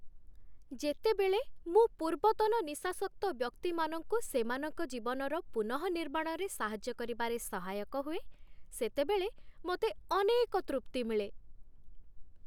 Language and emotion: Odia, happy